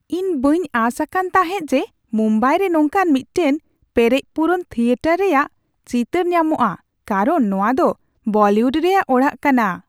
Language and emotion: Santali, surprised